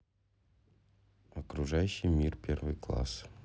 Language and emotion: Russian, neutral